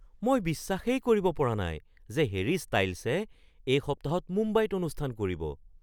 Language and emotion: Assamese, surprised